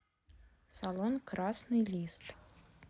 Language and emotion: Russian, neutral